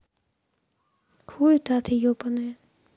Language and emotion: Russian, angry